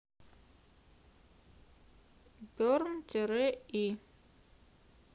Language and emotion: Russian, neutral